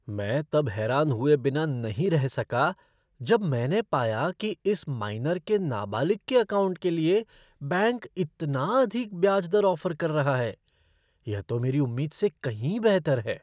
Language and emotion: Hindi, surprised